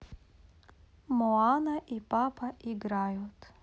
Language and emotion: Russian, positive